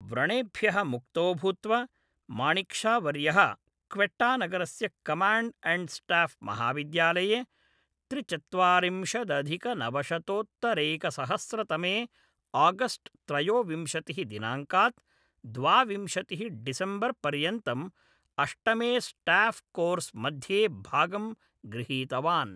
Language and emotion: Sanskrit, neutral